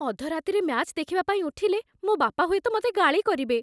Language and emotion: Odia, fearful